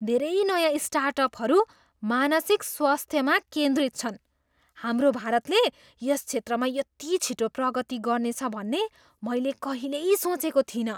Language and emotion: Nepali, surprised